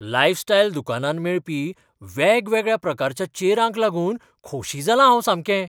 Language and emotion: Goan Konkani, surprised